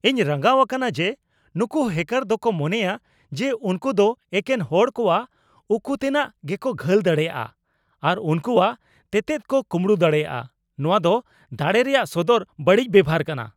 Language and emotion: Santali, angry